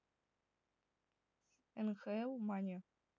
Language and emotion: Russian, neutral